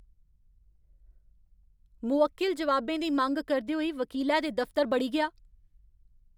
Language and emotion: Dogri, angry